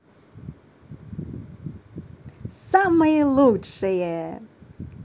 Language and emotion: Russian, positive